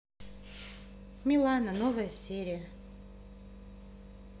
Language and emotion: Russian, neutral